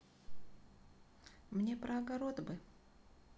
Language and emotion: Russian, neutral